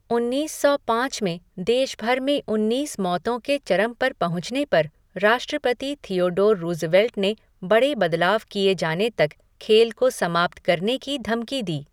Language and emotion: Hindi, neutral